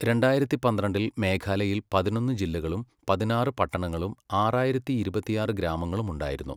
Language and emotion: Malayalam, neutral